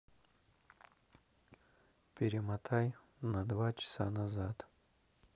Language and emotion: Russian, neutral